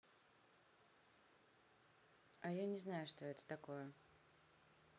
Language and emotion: Russian, neutral